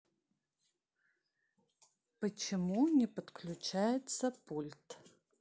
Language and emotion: Russian, neutral